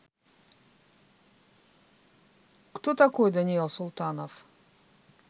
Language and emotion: Russian, neutral